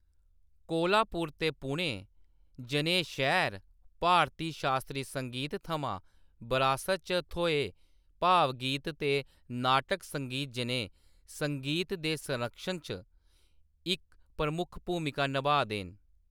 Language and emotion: Dogri, neutral